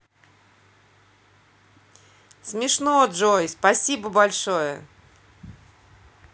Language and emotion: Russian, positive